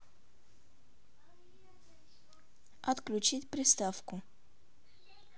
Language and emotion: Russian, neutral